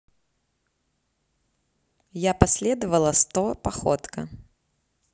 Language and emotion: Russian, neutral